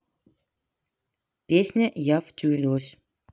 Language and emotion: Russian, neutral